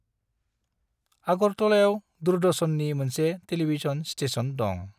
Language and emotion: Bodo, neutral